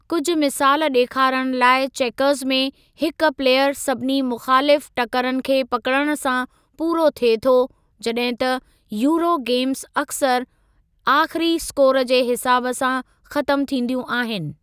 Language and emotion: Sindhi, neutral